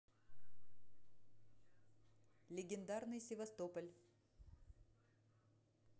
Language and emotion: Russian, neutral